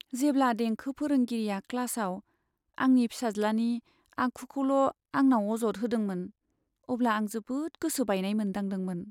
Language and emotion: Bodo, sad